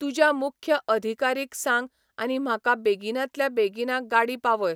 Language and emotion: Goan Konkani, neutral